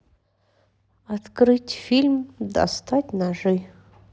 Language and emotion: Russian, sad